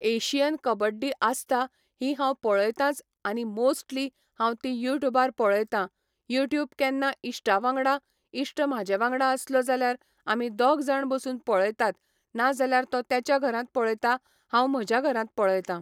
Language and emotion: Goan Konkani, neutral